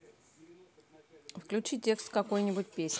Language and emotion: Russian, neutral